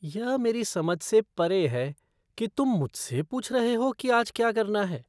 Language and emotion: Hindi, disgusted